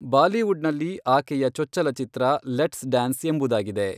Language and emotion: Kannada, neutral